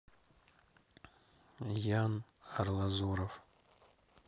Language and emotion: Russian, neutral